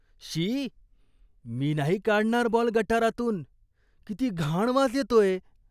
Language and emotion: Marathi, disgusted